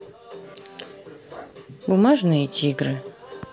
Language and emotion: Russian, neutral